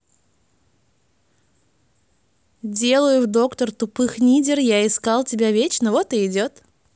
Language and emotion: Russian, neutral